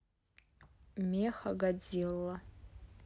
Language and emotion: Russian, neutral